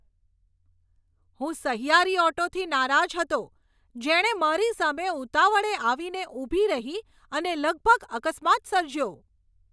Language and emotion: Gujarati, angry